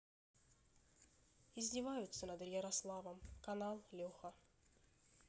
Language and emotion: Russian, neutral